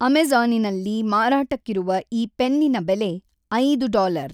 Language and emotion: Kannada, neutral